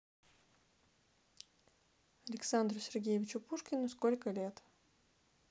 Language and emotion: Russian, neutral